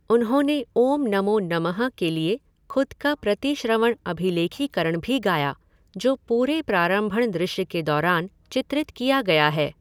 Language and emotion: Hindi, neutral